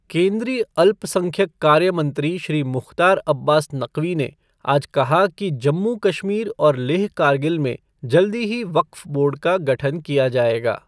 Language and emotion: Hindi, neutral